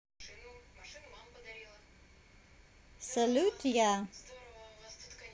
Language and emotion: Russian, neutral